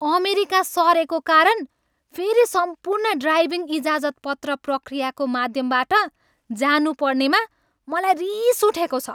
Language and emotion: Nepali, angry